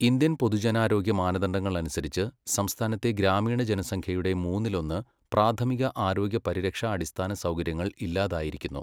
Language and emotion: Malayalam, neutral